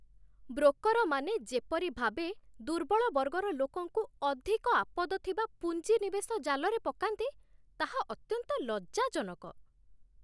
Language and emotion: Odia, disgusted